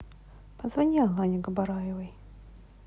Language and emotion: Russian, neutral